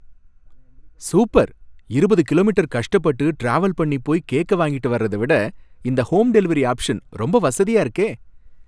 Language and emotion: Tamil, happy